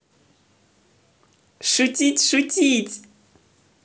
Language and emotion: Russian, positive